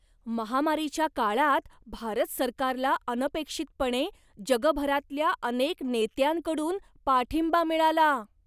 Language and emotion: Marathi, surprised